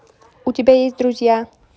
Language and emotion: Russian, neutral